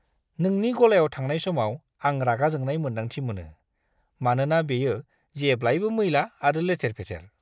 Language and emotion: Bodo, disgusted